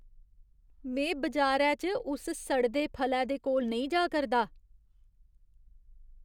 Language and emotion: Dogri, disgusted